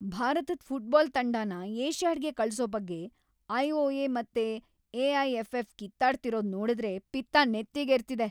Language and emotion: Kannada, angry